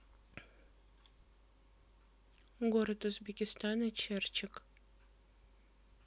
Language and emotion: Russian, neutral